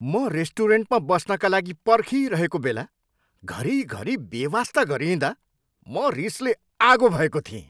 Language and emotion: Nepali, angry